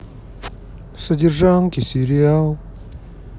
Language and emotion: Russian, sad